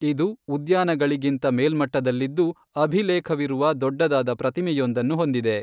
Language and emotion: Kannada, neutral